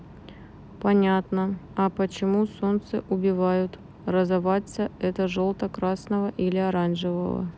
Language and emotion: Russian, neutral